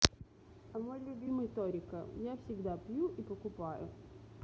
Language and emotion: Russian, neutral